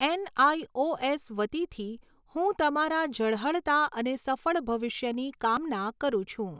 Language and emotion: Gujarati, neutral